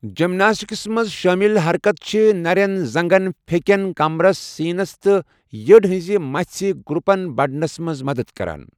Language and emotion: Kashmiri, neutral